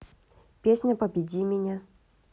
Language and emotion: Russian, neutral